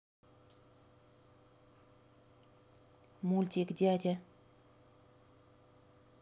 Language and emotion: Russian, neutral